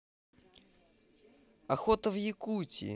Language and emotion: Russian, positive